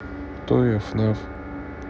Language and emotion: Russian, neutral